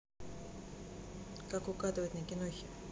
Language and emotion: Russian, neutral